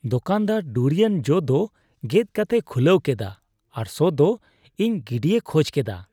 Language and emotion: Santali, disgusted